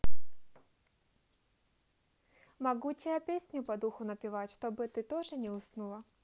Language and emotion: Russian, positive